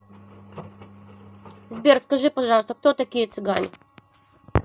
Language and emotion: Russian, neutral